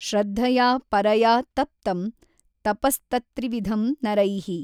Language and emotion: Kannada, neutral